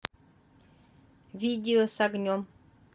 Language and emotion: Russian, neutral